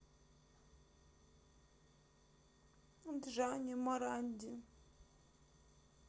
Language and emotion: Russian, sad